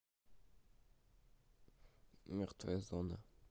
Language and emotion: Russian, neutral